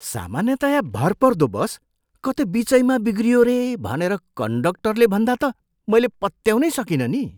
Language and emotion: Nepali, surprised